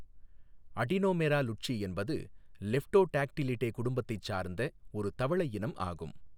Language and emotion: Tamil, neutral